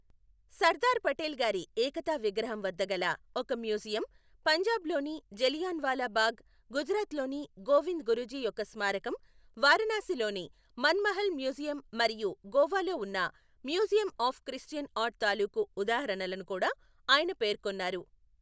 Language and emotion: Telugu, neutral